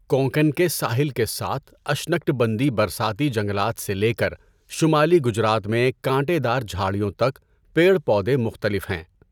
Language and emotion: Urdu, neutral